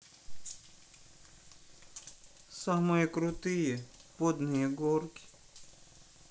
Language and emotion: Russian, sad